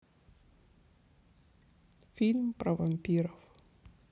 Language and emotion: Russian, sad